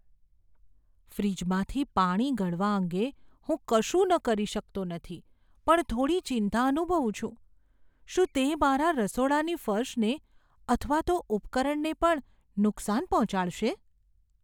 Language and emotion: Gujarati, fearful